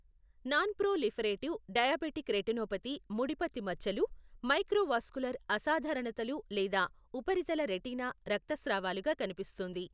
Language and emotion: Telugu, neutral